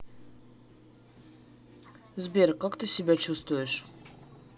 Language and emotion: Russian, neutral